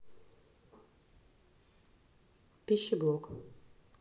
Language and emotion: Russian, neutral